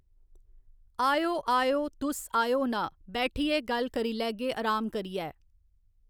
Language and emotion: Dogri, neutral